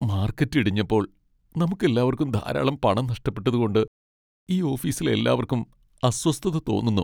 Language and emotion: Malayalam, sad